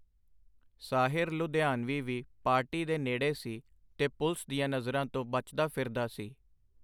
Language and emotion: Punjabi, neutral